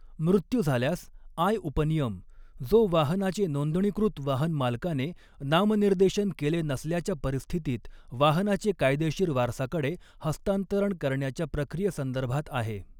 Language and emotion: Marathi, neutral